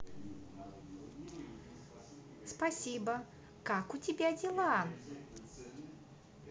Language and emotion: Russian, positive